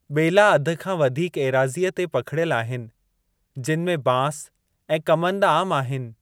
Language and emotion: Sindhi, neutral